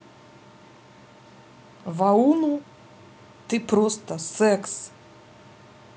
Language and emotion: Russian, neutral